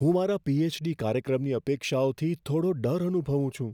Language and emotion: Gujarati, fearful